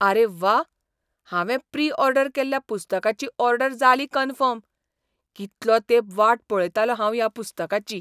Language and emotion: Goan Konkani, surprised